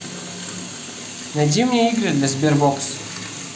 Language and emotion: Russian, neutral